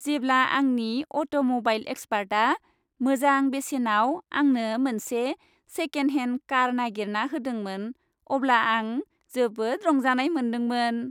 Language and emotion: Bodo, happy